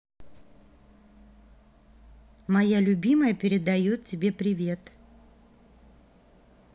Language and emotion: Russian, positive